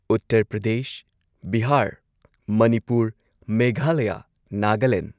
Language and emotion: Manipuri, neutral